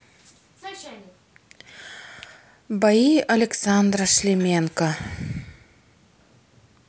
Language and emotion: Russian, sad